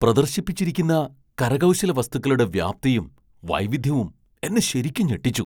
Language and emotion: Malayalam, surprised